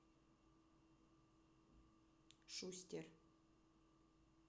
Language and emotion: Russian, neutral